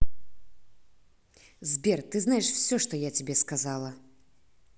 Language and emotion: Russian, positive